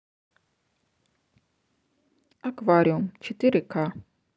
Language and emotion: Russian, neutral